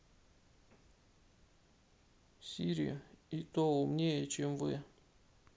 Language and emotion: Russian, sad